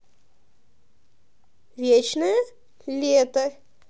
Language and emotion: Russian, positive